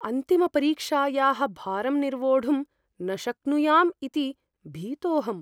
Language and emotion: Sanskrit, fearful